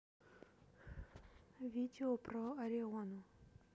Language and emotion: Russian, neutral